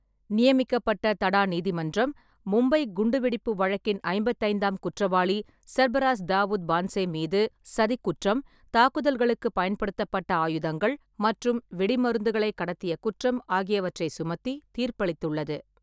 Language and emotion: Tamil, neutral